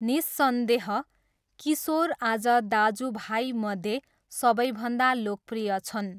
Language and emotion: Nepali, neutral